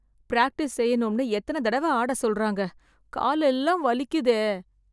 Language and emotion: Tamil, sad